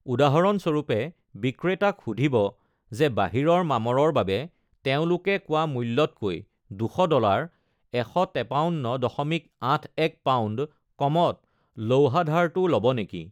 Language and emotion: Assamese, neutral